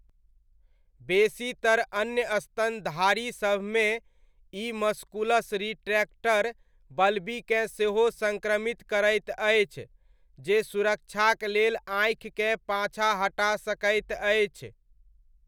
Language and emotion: Maithili, neutral